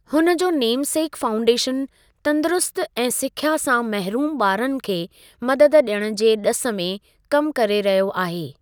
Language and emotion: Sindhi, neutral